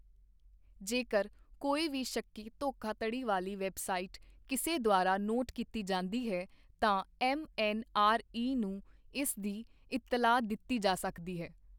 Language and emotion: Punjabi, neutral